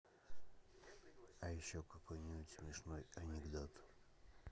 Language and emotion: Russian, neutral